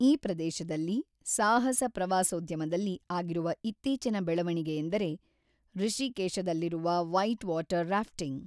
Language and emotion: Kannada, neutral